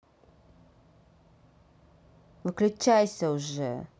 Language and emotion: Russian, angry